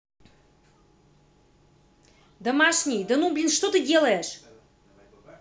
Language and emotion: Russian, angry